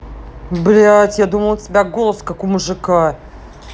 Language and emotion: Russian, angry